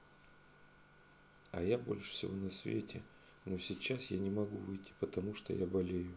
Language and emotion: Russian, sad